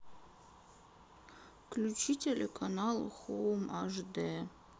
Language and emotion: Russian, sad